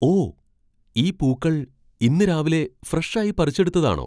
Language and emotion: Malayalam, surprised